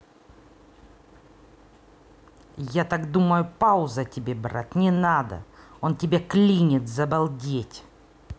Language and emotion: Russian, angry